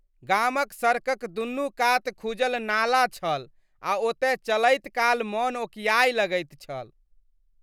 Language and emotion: Maithili, disgusted